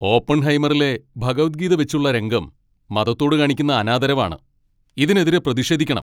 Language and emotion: Malayalam, angry